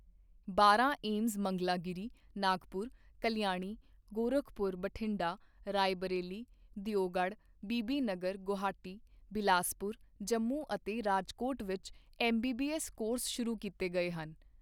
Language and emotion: Punjabi, neutral